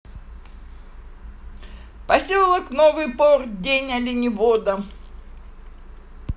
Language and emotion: Russian, positive